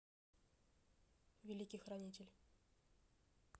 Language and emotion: Russian, neutral